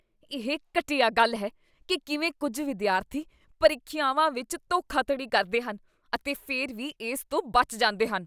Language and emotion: Punjabi, disgusted